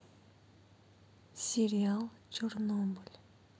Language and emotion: Russian, sad